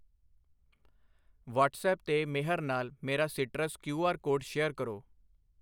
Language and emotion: Punjabi, neutral